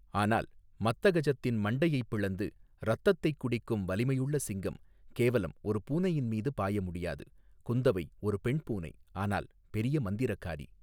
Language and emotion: Tamil, neutral